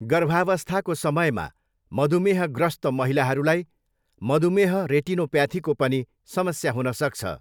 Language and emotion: Nepali, neutral